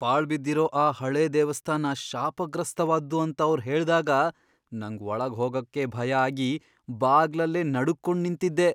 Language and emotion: Kannada, fearful